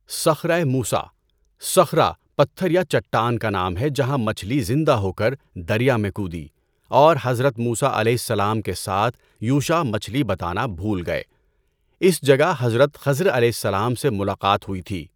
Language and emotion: Urdu, neutral